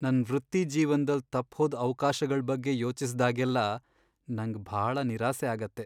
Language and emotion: Kannada, sad